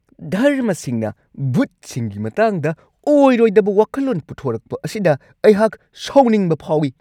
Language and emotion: Manipuri, angry